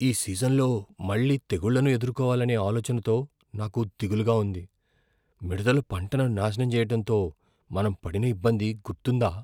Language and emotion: Telugu, fearful